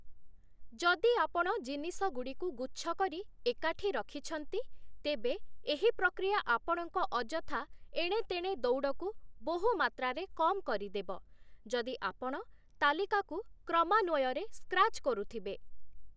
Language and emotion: Odia, neutral